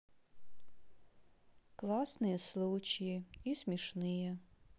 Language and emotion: Russian, sad